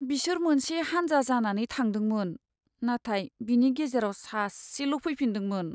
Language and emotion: Bodo, sad